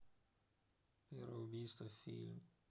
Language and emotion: Russian, neutral